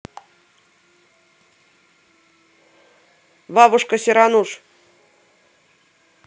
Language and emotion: Russian, neutral